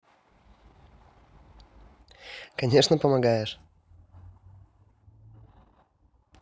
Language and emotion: Russian, positive